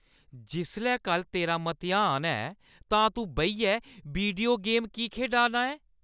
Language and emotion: Dogri, angry